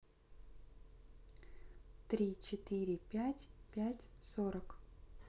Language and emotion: Russian, neutral